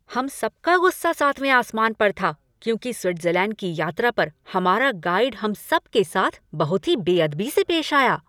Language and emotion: Hindi, angry